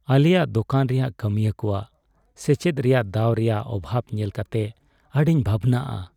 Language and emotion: Santali, sad